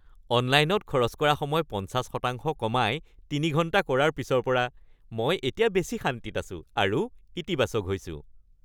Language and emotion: Assamese, happy